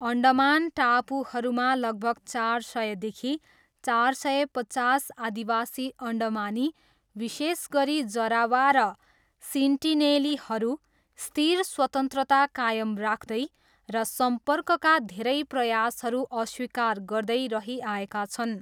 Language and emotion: Nepali, neutral